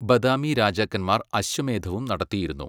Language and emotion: Malayalam, neutral